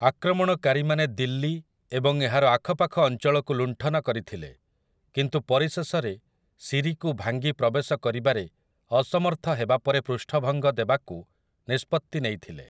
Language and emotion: Odia, neutral